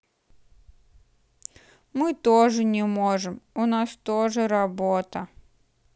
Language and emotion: Russian, sad